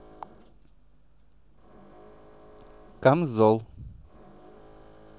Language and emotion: Russian, neutral